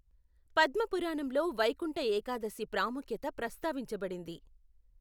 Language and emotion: Telugu, neutral